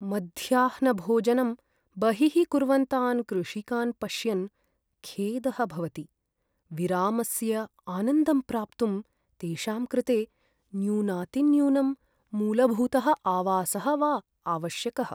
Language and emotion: Sanskrit, sad